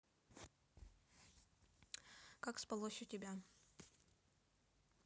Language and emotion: Russian, neutral